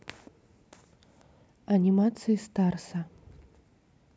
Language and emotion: Russian, neutral